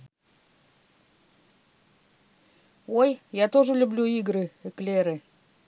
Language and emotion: Russian, neutral